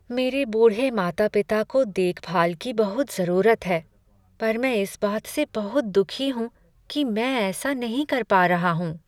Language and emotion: Hindi, sad